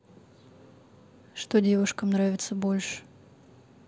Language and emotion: Russian, neutral